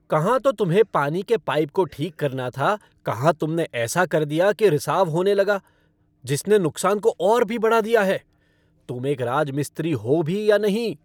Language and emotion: Hindi, angry